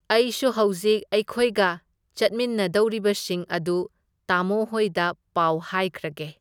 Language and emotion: Manipuri, neutral